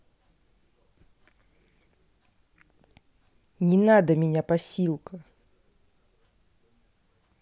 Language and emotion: Russian, angry